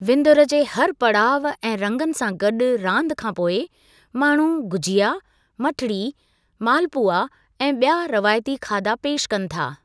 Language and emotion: Sindhi, neutral